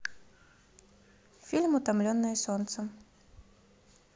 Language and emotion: Russian, neutral